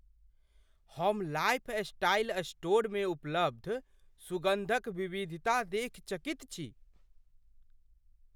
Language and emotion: Maithili, surprised